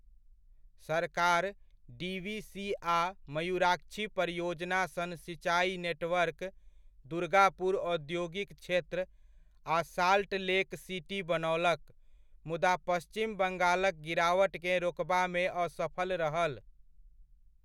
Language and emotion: Maithili, neutral